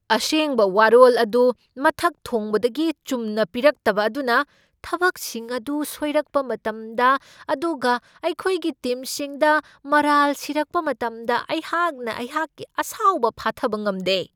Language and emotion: Manipuri, angry